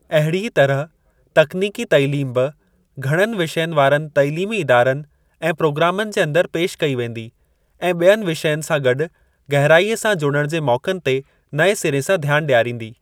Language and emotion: Sindhi, neutral